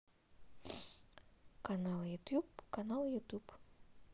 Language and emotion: Russian, neutral